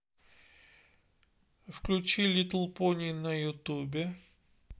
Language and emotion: Russian, neutral